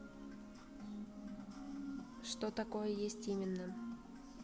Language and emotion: Russian, neutral